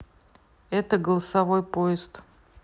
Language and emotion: Russian, neutral